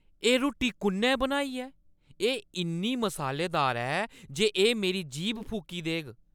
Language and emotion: Dogri, angry